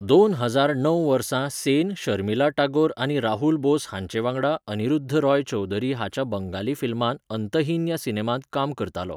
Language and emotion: Goan Konkani, neutral